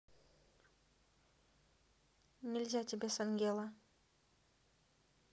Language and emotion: Russian, neutral